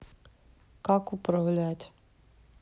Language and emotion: Russian, neutral